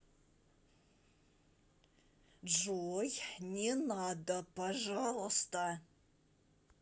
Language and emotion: Russian, angry